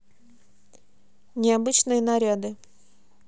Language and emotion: Russian, neutral